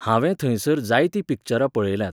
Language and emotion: Goan Konkani, neutral